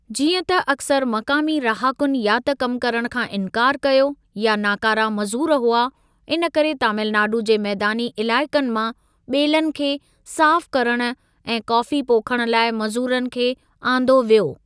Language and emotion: Sindhi, neutral